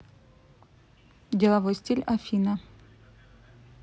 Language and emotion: Russian, neutral